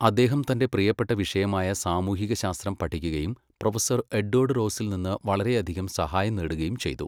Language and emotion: Malayalam, neutral